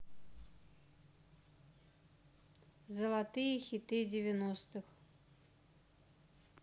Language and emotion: Russian, neutral